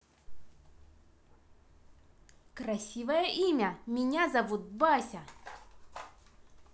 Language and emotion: Russian, positive